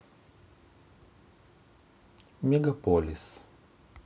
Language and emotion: Russian, neutral